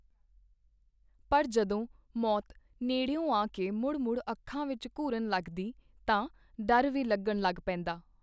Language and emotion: Punjabi, neutral